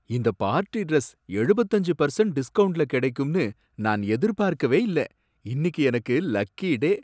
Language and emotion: Tamil, surprised